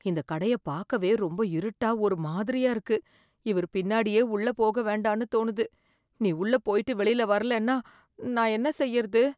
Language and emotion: Tamil, fearful